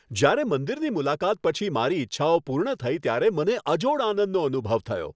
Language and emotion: Gujarati, happy